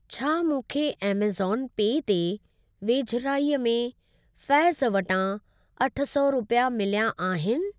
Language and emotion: Sindhi, neutral